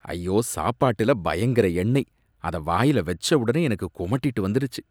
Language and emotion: Tamil, disgusted